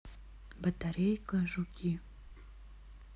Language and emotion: Russian, neutral